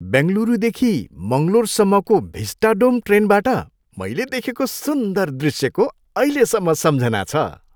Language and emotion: Nepali, happy